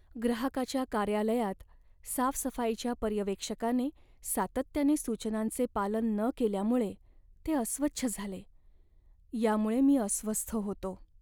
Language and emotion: Marathi, sad